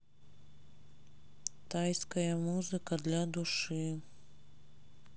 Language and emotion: Russian, sad